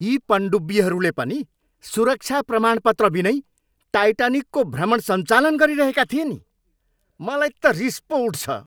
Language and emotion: Nepali, angry